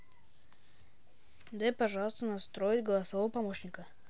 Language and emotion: Russian, neutral